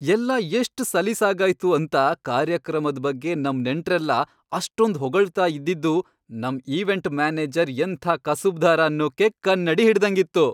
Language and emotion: Kannada, happy